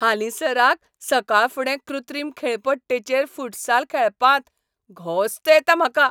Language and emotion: Goan Konkani, happy